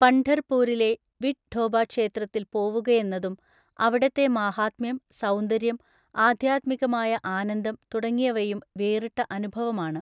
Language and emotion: Malayalam, neutral